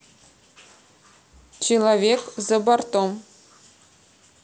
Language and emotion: Russian, neutral